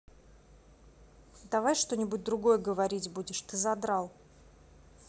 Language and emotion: Russian, angry